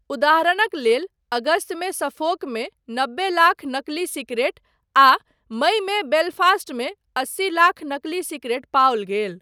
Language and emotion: Maithili, neutral